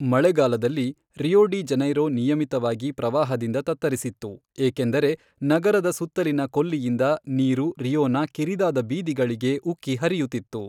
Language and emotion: Kannada, neutral